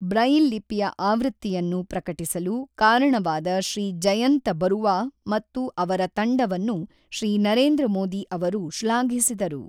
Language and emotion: Kannada, neutral